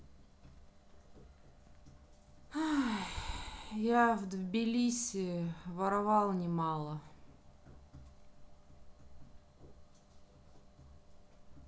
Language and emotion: Russian, sad